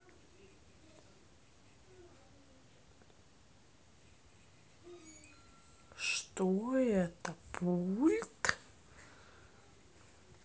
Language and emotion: Russian, neutral